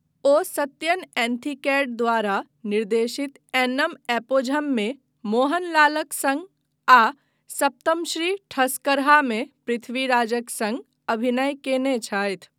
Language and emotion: Maithili, neutral